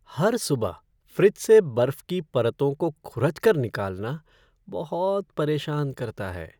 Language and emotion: Hindi, sad